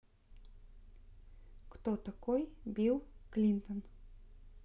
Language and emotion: Russian, neutral